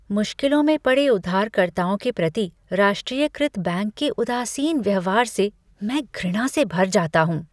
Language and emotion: Hindi, disgusted